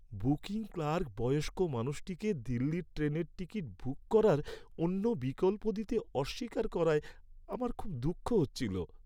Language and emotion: Bengali, sad